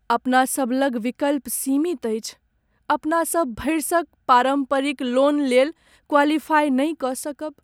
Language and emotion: Maithili, sad